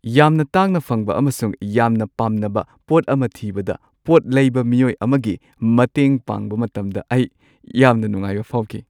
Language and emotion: Manipuri, happy